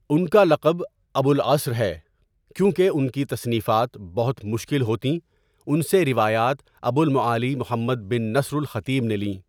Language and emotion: Urdu, neutral